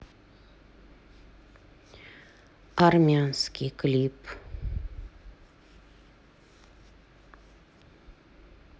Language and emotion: Russian, neutral